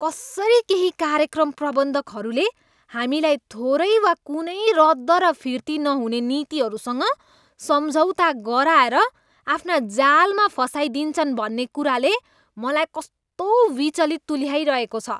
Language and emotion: Nepali, disgusted